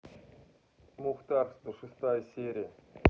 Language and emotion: Russian, neutral